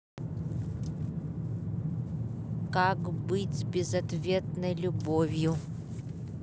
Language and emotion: Russian, neutral